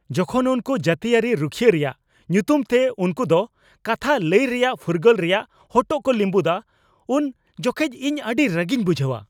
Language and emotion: Santali, angry